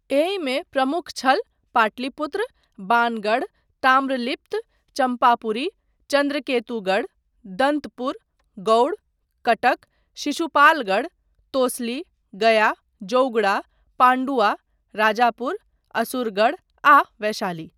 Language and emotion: Maithili, neutral